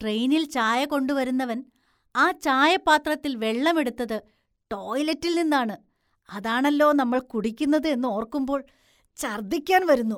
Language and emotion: Malayalam, disgusted